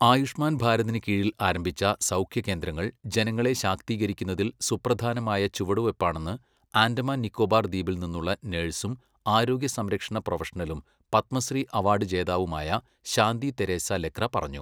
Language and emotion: Malayalam, neutral